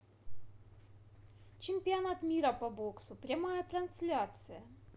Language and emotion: Russian, positive